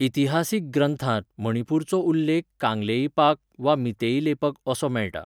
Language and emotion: Goan Konkani, neutral